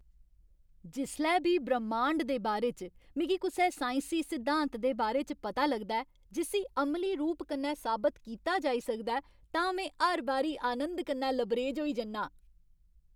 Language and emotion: Dogri, happy